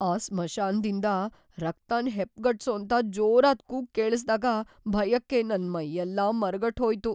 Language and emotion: Kannada, fearful